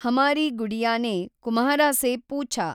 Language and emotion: Kannada, neutral